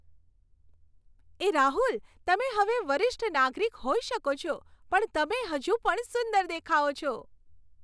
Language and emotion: Gujarati, happy